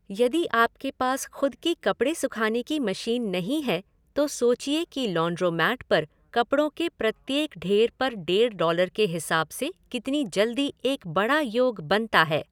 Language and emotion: Hindi, neutral